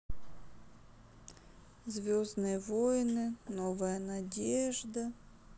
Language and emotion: Russian, sad